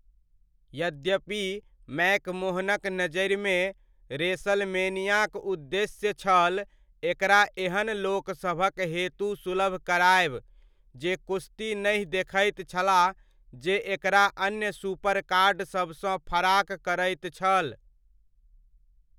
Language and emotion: Maithili, neutral